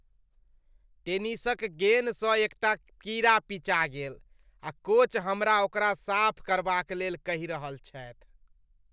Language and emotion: Maithili, disgusted